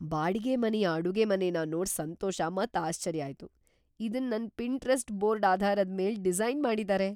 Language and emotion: Kannada, surprised